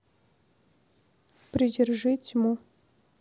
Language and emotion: Russian, neutral